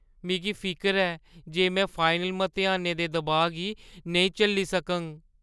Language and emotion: Dogri, fearful